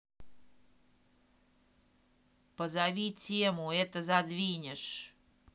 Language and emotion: Russian, angry